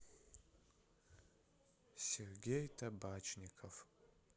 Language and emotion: Russian, sad